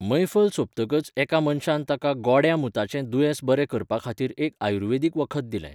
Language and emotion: Goan Konkani, neutral